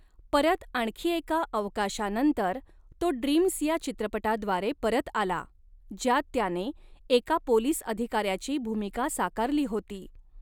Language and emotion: Marathi, neutral